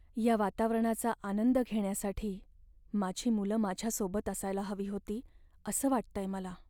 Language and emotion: Marathi, sad